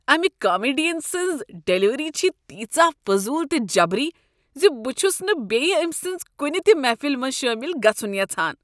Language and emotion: Kashmiri, disgusted